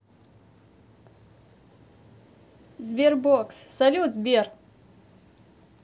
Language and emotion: Russian, positive